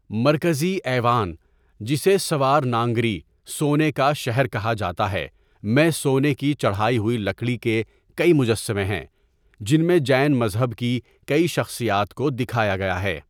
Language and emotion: Urdu, neutral